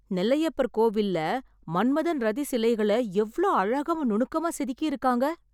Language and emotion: Tamil, surprised